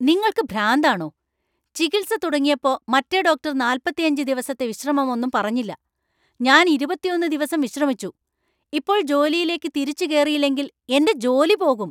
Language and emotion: Malayalam, angry